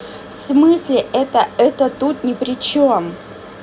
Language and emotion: Russian, angry